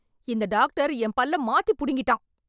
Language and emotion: Tamil, angry